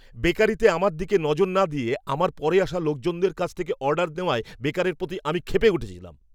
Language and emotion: Bengali, angry